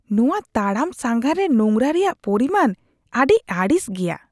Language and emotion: Santali, disgusted